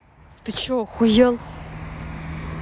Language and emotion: Russian, angry